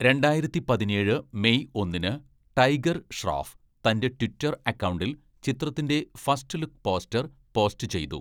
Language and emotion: Malayalam, neutral